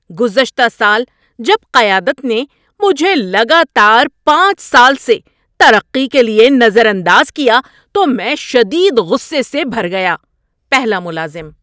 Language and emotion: Urdu, angry